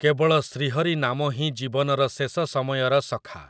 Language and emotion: Odia, neutral